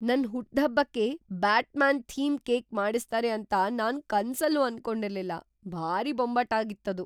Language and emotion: Kannada, surprised